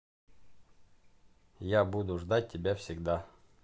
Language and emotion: Russian, neutral